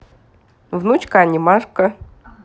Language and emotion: Russian, positive